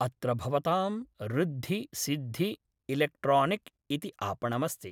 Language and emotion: Sanskrit, neutral